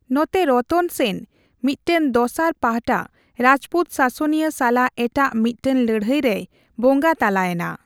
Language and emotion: Santali, neutral